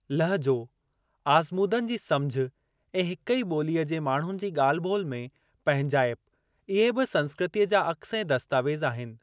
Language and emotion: Sindhi, neutral